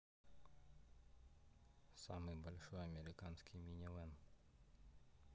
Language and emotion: Russian, sad